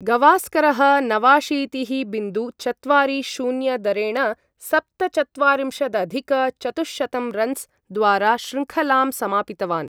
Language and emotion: Sanskrit, neutral